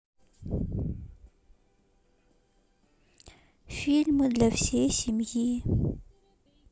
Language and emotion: Russian, sad